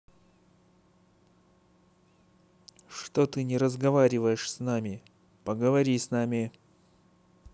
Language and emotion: Russian, angry